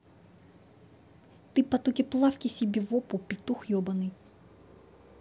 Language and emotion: Russian, angry